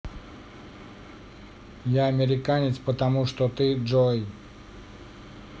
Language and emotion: Russian, neutral